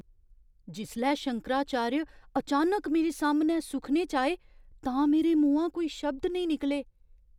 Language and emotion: Dogri, surprised